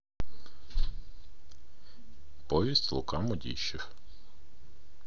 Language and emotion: Russian, neutral